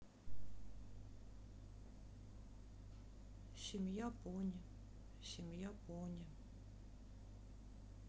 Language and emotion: Russian, sad